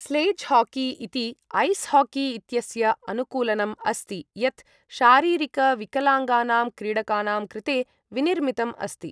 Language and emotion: Sanskrit, neutral